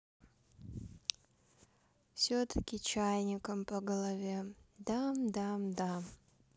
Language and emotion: Russian, sad